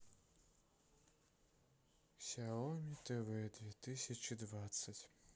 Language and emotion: Russian, sad